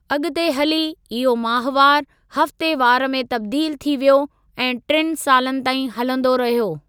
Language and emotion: Sindhi, neutral